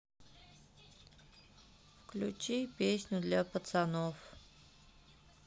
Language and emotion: Russian, sad